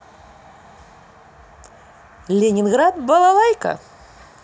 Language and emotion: Russian, positive